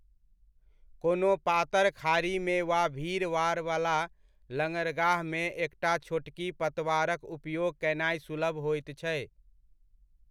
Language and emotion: Maithili, neutral